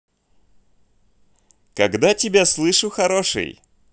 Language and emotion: Russian, positive